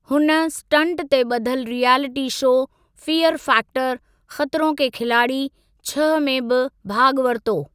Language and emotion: Sindhi, neutral